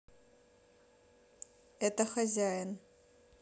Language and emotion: Russian, neutral